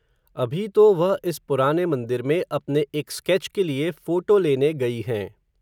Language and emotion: Hindi, neutral